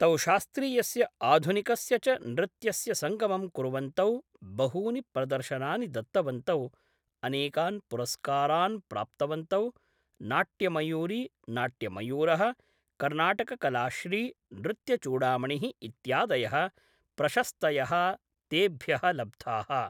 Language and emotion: Sanskrit, neutral